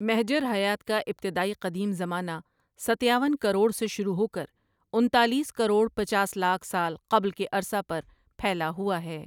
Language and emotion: Urdu, neutral